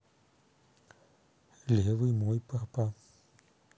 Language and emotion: Russian, neutral